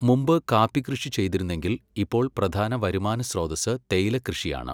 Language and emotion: Malayalam, neutral